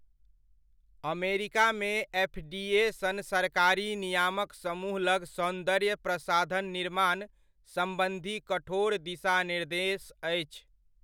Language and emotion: Maithili, neutral